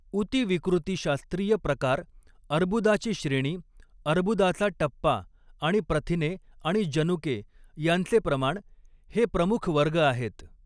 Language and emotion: Marathi, neutral